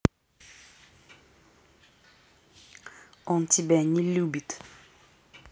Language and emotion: Russian, angry